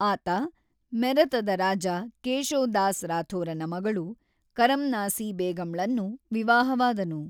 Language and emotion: Kannada, neutral